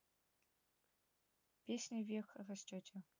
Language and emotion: Russian, neutral